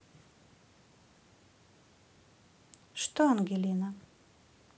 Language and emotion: Russian, neutral